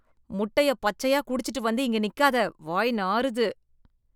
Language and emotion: Tamil, disgusted